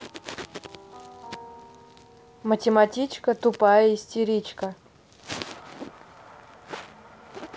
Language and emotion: Russian, neutral